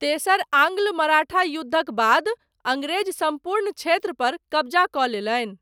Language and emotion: Maithili, neutral